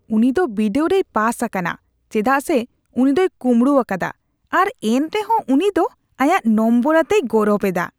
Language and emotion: Santali, disgusted